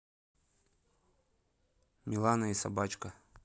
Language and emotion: Russian, neutral